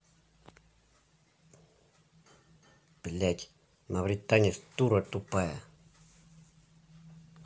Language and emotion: Russian, angry